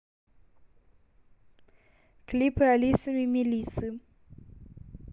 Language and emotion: Russian, neutral